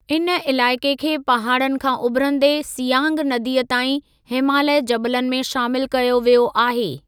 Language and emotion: Sindhi, neutral